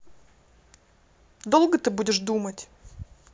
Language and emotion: Russian, angry